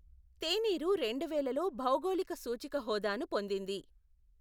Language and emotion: Telugu, neutral